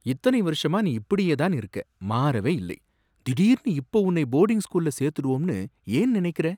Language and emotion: Tamil, surprised